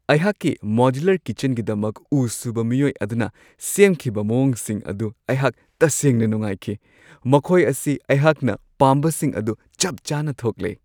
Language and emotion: Manipuri, happy